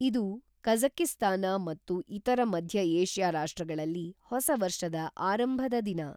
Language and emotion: Kannada, neutral